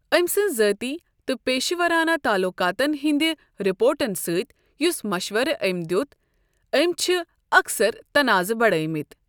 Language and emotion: Kashmiri, neutral